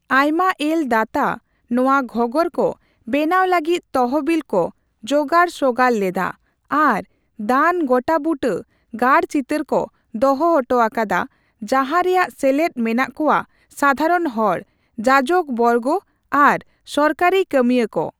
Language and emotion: Santali, neutral